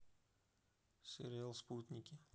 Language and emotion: Russian, neutral